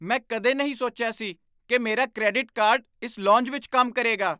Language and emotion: Punjabi, surprised